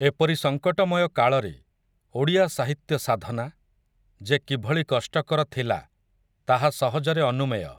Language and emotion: Odia, neutral